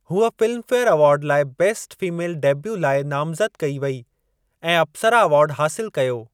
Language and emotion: Sindhi, neutral